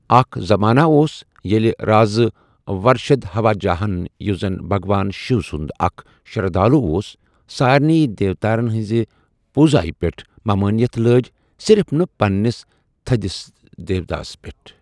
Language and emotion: Kashmiri, neutral